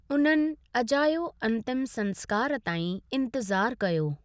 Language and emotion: Sindhi, neutral